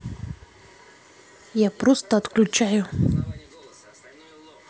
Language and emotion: Russian, neutral